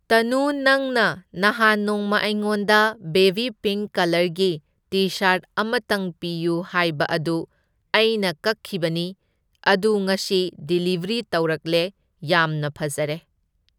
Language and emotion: Manipuri, neutral